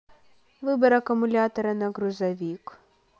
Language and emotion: Russian, neutral